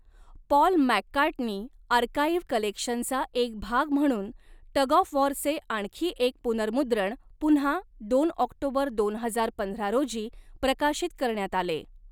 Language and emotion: Marathi, neutral